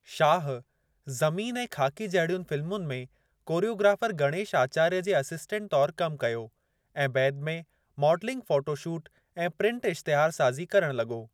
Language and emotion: Sindhi, neutral